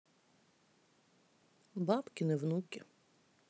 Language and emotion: Russian, sad